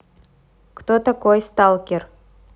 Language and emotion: Russian, neutral